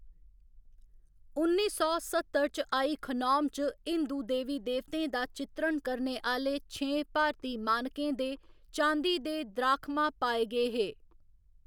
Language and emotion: Dogri, neutral